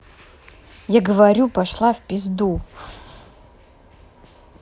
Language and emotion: Russian, angry